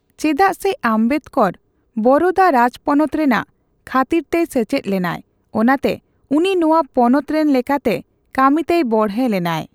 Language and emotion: Santali, neutral